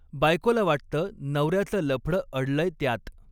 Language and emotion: Marathi, neutral